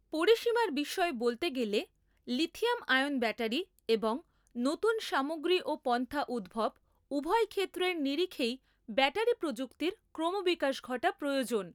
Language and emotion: Bengali, neutral